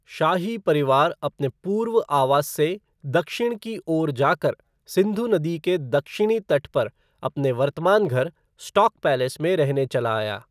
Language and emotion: Hindi, neutral